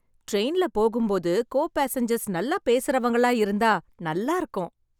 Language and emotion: Tamil, happy